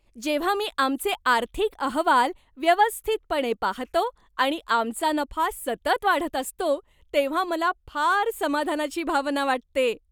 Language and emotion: Marathi, happy